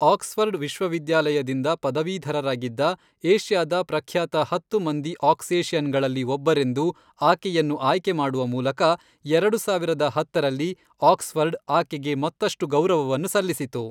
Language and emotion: Kannada, neutral